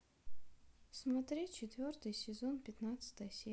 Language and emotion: Russian, sad